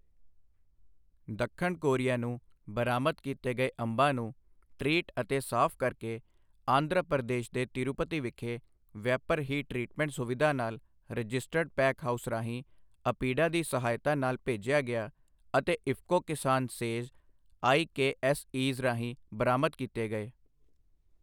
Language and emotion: Punjabi, neutral